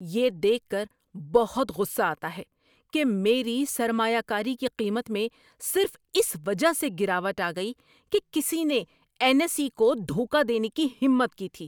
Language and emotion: Urdu, angry